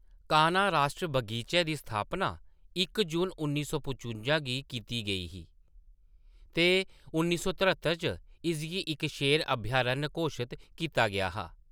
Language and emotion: Dogri, neutral